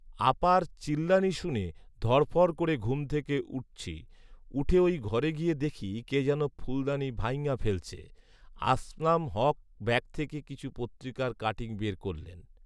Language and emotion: Bengali, neutral